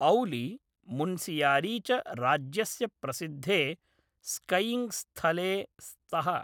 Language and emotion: Sanskrit, neutral